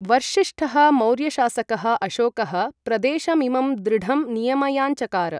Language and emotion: Sanskrit, neutral